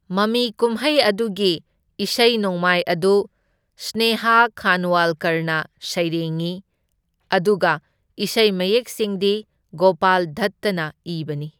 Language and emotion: Manipuri, neutral